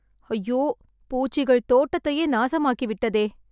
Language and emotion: Tamil, sad